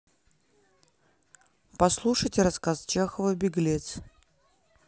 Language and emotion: Russian, neutral